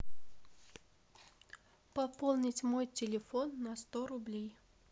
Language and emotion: Russian, neutral